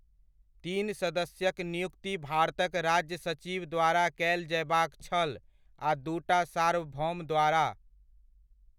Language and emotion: Maithili, neutral